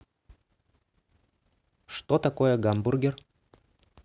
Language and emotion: Russian, neutral